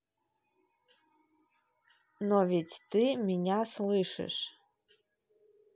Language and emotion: Russian, neutral